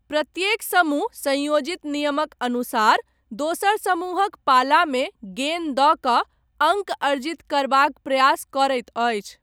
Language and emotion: Maithili, neutral